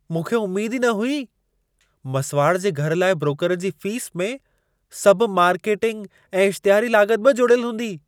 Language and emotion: Sindhi, surprised